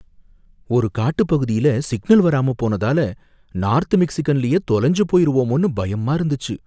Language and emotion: Tamil, fearful